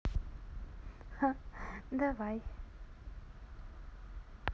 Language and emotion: Russian, positive